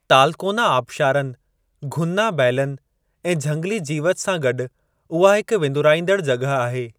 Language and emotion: Sindhi, neutral